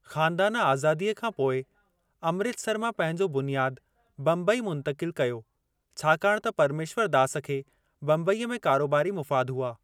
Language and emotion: Sindhi, neutral